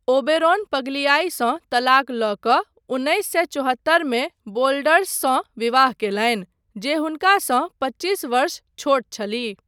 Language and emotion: Maithili, neutral